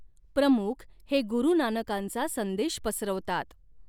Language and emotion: Marathi, neutral